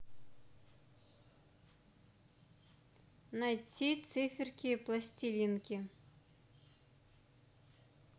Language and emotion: Russian, neutral